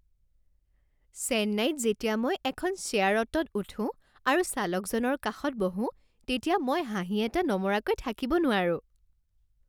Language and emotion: Assamese, happy